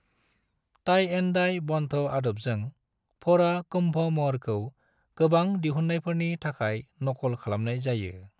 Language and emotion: Bodo, neutral